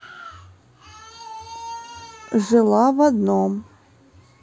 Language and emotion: Russian, neutral